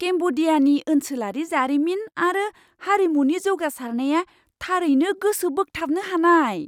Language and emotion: Bodo, surprised